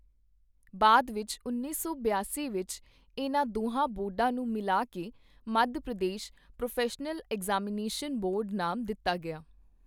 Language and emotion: Punjabi, neutral